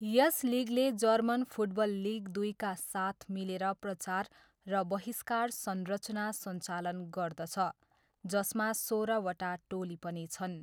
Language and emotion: Nepali, neutral